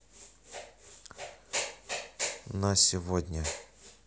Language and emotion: Russian, neutral